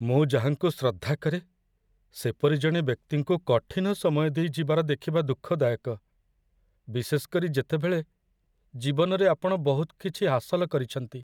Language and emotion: Odia, sad